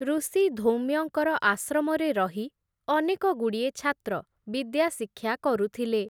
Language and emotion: Odia, neutral